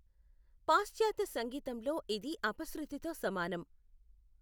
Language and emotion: Telugu, neutral